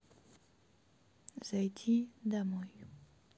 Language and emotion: Russian, sad